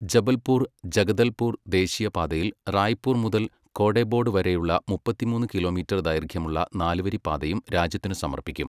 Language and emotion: Malayalam, neutral